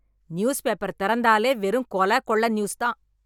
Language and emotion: Tamil, angry